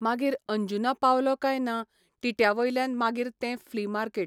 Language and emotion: Goan Konkani, neutral